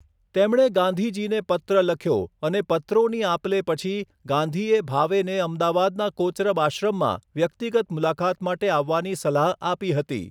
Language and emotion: Gujarati, neutral